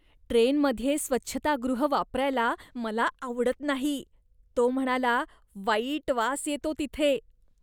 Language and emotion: Marathi, disgusted